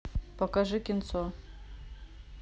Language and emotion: Russian, neutral